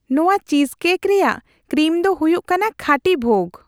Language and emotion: Santali, happy